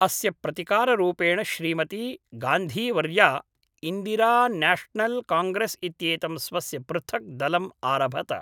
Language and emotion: Sanskrit, neutral